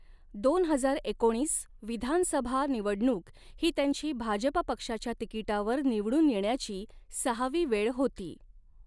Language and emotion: Marathi, neutral